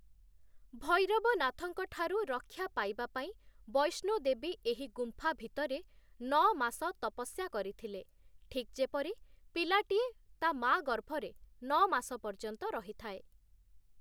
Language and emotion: Odia, neutral